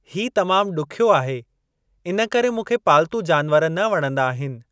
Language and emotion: Sindhi, neutral